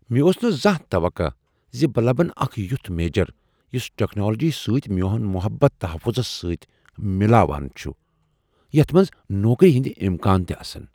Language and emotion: Kashmiri, surprised